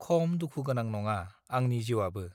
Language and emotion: Bodo, neutral